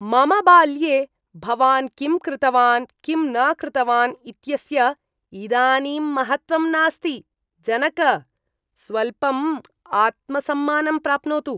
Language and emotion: Sanskrit, disgusted